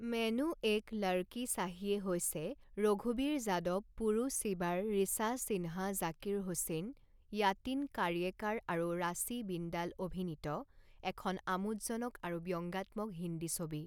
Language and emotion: Assamese, neutral